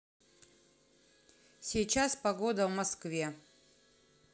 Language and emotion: Russian, positive